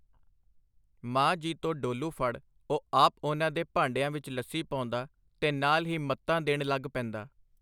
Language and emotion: Punjabi, neutral